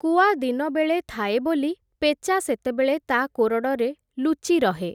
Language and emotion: Odia, neutral